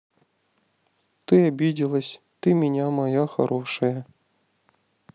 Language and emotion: Russian, sad